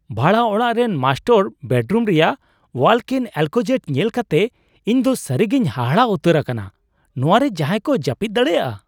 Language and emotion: Santali, surprised